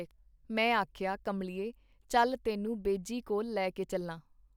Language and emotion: Punjabi, neutral